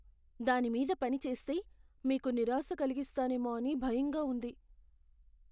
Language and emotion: Telugu, fearful